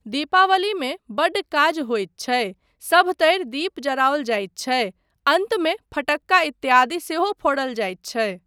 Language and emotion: Maithili, neutral